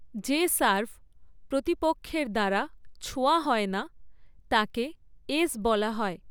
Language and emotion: Bengali, neutral